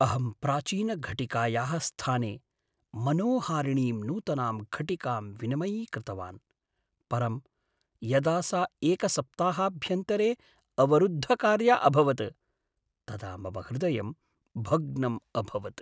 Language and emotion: Sanskrit, sad